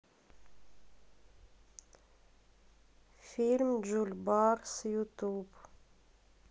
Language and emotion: Russian, sad